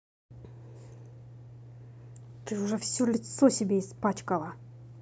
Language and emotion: Russian, angry